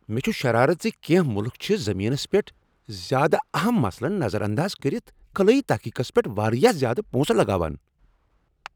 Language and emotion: Kashmiri, angry